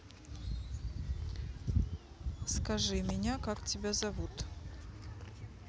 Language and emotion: Russian, neutral